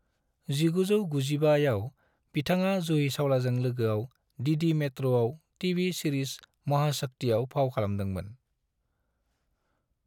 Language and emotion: Bodo, neutral